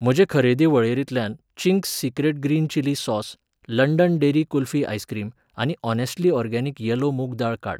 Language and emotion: Goan Konkani, neutral